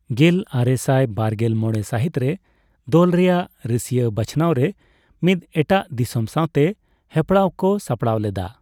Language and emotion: Santali, neutral